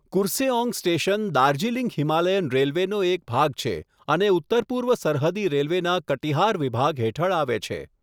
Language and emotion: Gujarati, neutral